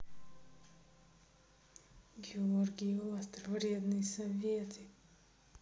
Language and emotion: Russian, neutral